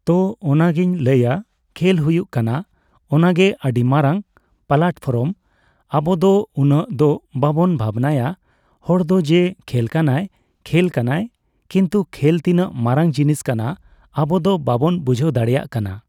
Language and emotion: Santali, neutral